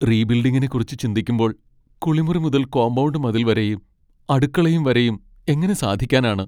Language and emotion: Malayalam, sad